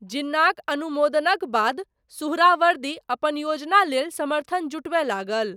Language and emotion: Maithili, neutral